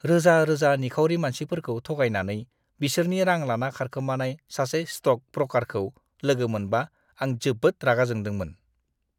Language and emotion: Bodo, disgusted